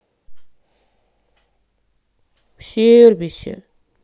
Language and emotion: Russian, sad